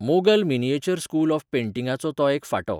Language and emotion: Goan Konkani, neutral